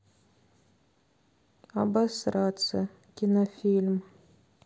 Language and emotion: Russian, neutral